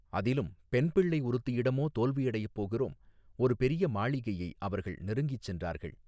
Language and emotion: Tamil, neutral